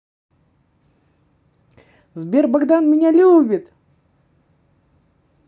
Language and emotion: Russian, positive